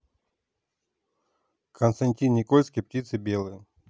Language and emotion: Russian, neutral